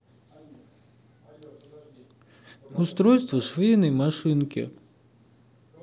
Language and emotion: Russian, neutral